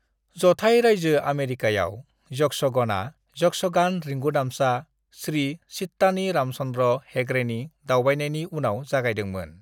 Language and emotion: Bodo, neutral